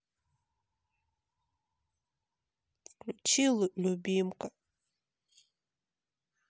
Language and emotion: Russian, sad